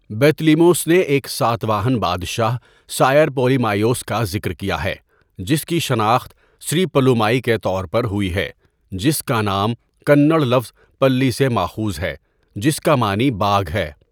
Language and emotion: Urdu, neutral